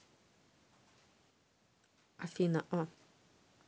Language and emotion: Russian, neutral